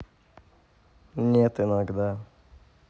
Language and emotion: Russian, neutral